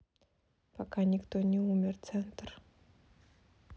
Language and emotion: Russian, neutral